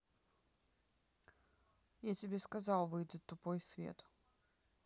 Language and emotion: Russian, neutral